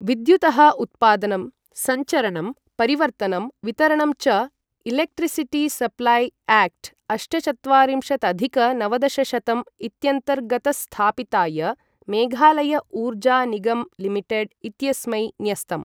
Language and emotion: Sanskrit, neutral